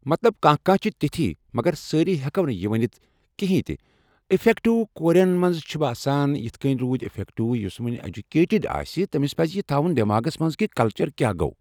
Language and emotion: Kashmiri, neutral